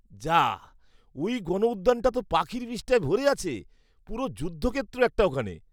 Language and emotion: Bengali, disgusted